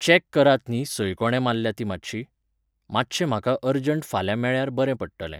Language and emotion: Goan Konkani, neutral